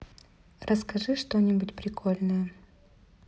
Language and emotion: Russian, neutral